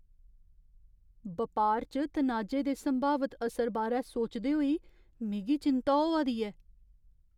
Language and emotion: Dogri, fearful